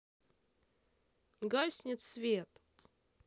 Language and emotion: Russian, neutral